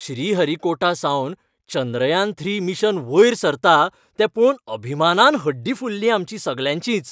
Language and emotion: Goan Konkani, happy